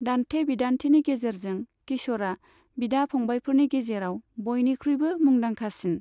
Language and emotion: Bodo, neutral